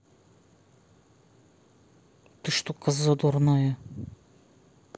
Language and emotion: Russian, angry